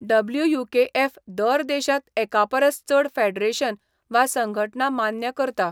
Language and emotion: Goan Konkani, neutral